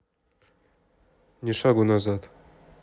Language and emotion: Russian, neutral